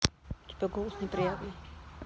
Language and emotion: Russian, neutral